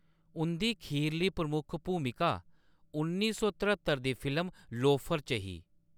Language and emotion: Dogri, neutral